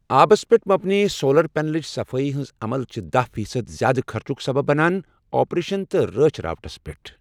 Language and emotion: Kashmiri, neutral